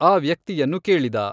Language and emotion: Kannada, neutral